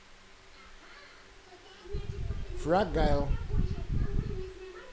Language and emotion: Russian, neutral